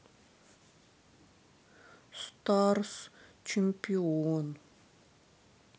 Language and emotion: Russian, sad